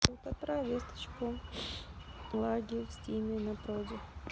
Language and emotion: Russian, neutral